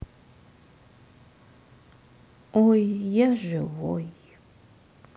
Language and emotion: Russian, sad